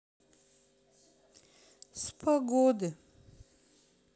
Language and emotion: Russian, sad